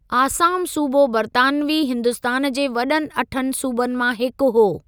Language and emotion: Sindhi, neutral